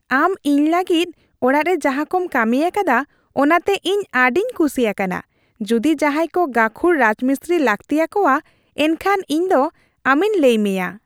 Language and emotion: Santali, happy